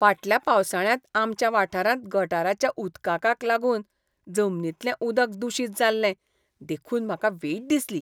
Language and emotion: Goan Konkani, disgusted